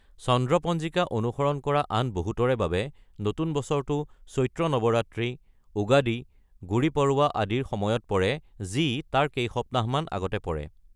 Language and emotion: Assamese, neutral